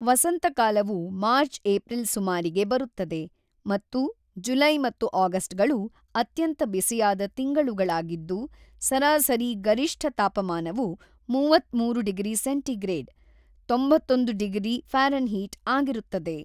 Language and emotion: Kannada, neutral